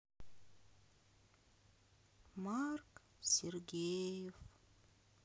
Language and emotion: Russian, sad